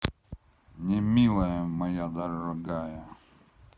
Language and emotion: Russian, neutral